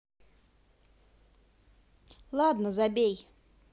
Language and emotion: Russian, positive